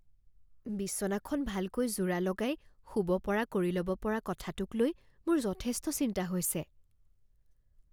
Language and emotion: Assamese, fearful